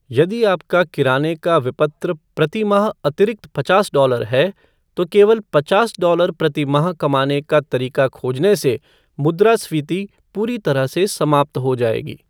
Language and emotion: Hindi, neutral